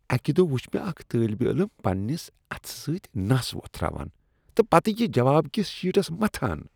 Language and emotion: Kashmiri, disgusted